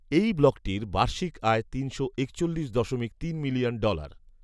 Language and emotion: Bengali, neutral